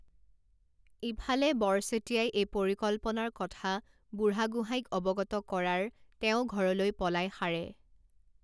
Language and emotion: Assamese, neutral